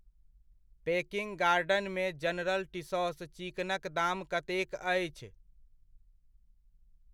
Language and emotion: Maithili, neutral